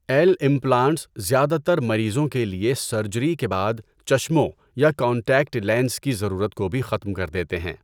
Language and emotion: Urdu, neutral